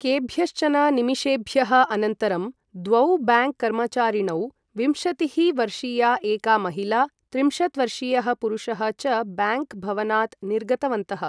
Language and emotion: Sanskrit, neutral